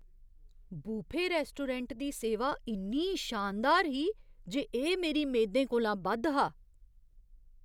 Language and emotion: Dogri, surprised